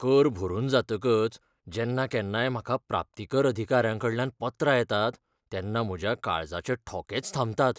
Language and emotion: Goan Konkani, fearful